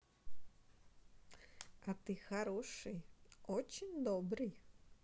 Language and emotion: Russian, positive